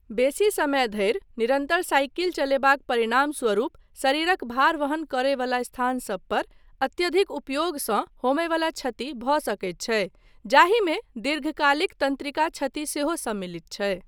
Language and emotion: Maithili, neutral